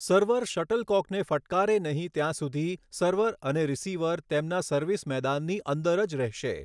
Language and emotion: Gujarati, neutral